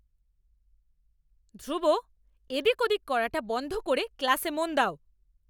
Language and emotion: Bengali, angry